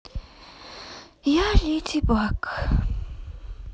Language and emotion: Russian, sad